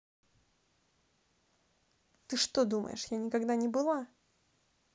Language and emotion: Russian, angry